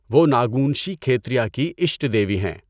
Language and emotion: Urdu, neutral